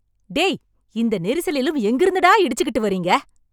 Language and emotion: Tamil, angry